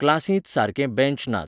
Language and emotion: Goan Konkani, neutral